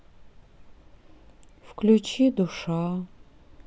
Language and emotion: Russian, sad